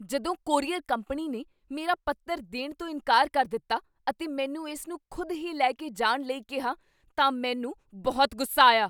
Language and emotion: Punjabi, angry